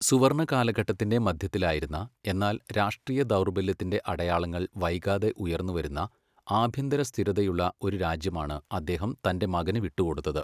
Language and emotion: Malayalam, neutral